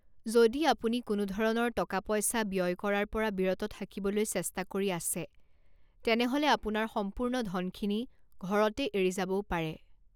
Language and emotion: Assamese, neutral